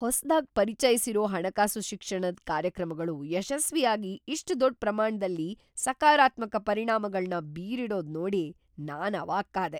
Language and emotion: Kannada, surprised